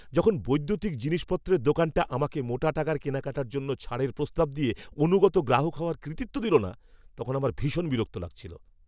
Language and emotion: Bengali, angry